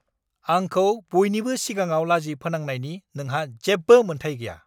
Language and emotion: Bodo, angry